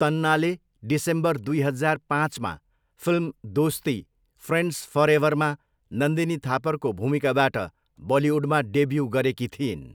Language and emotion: Nepali, neutral